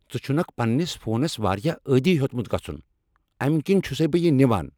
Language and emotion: Kashmiri, angry